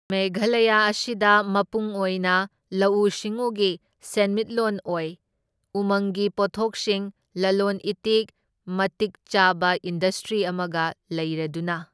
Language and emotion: Manipuri, neutral